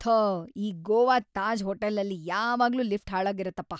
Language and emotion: Kannada, disgusted